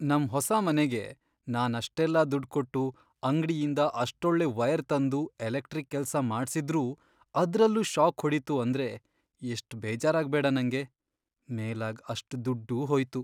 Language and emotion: Kannada, sad